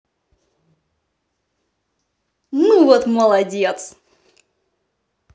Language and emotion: Russian, positive